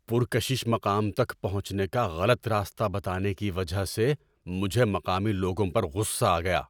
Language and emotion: Urdu, angry